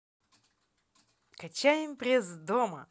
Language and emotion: Russian, positive